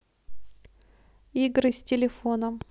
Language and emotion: Russian, neutral